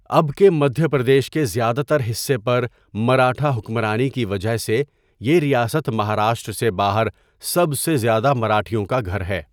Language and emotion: Urdu, neutral